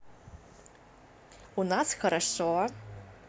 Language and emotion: Russian, positive